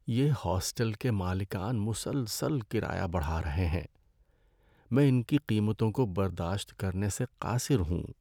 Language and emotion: Urdu, sad